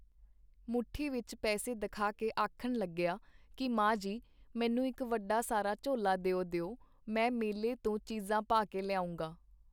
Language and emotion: Punjabi, neutral